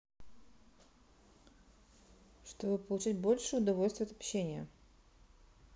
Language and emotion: Russian, neutral